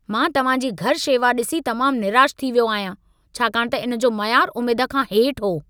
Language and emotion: Sindhi, angry